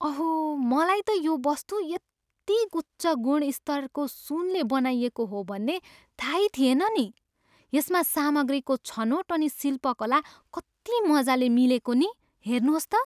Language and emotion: Nepali, surprised